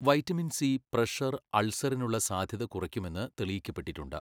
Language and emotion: Malayalam, neutral